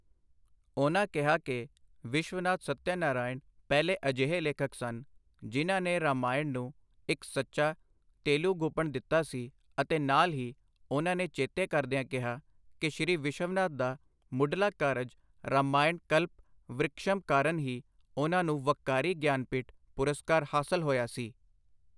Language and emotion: Punjabi, neutral